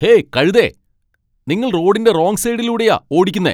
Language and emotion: Malayalam, angry